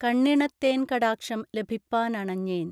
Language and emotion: Malayalam, neutral